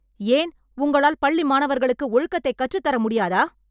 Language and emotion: Tamil, angry